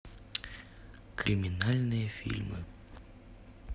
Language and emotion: Russian, neutral